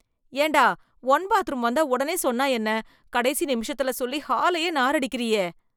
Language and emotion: Tamil, disgusted